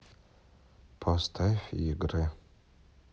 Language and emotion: Russian, neutral